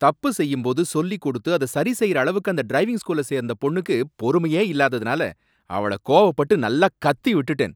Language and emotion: Tamil, angry